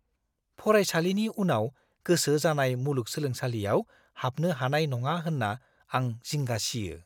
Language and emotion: Bodo, fearful